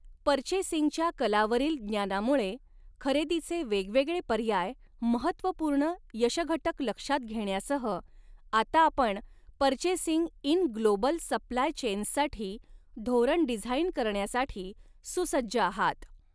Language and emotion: Marathi, neutral